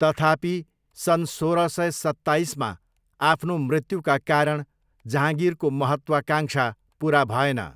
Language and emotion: Nepali, neutral